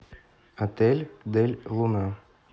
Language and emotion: Russian, neutral